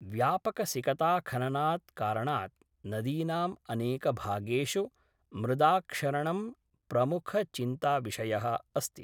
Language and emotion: Sanskrit, neutral